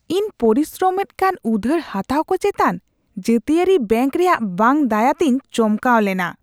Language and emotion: Santali, disgusted